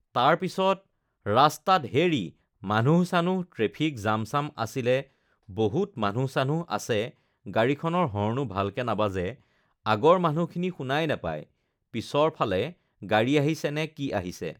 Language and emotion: Assamese, neutral